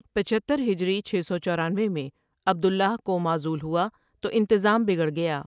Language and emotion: Urdu, neutral